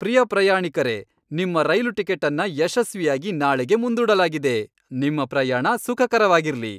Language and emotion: Kannada, happy